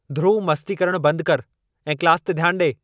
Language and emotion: Sindhi, angry